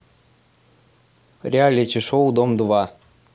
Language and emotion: Russian, neutral